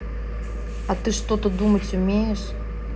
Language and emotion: Russian, angry